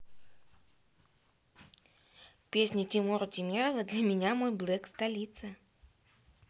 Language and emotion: Russian, neutral